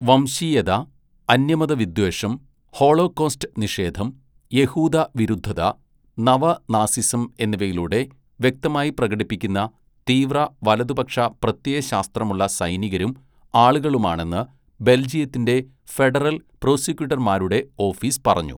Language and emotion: Malayalam, neutral